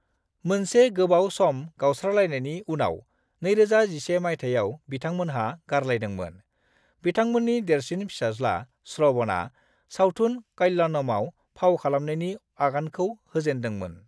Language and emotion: Bodo, neutral